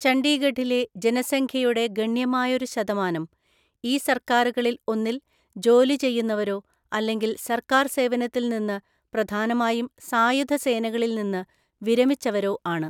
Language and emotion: Malayalam, neutral